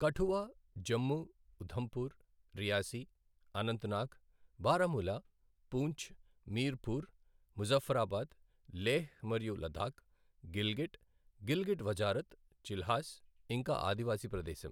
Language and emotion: Telugu, neutral